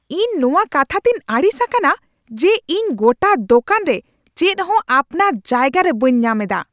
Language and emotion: Santali, angry